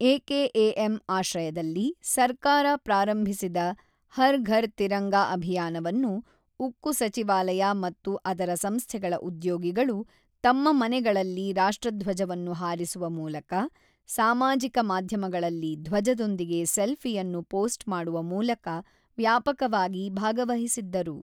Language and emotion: Kannada, neutral